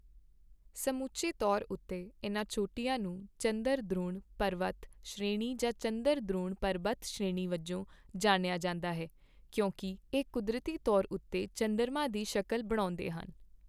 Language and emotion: Punjabi, neutral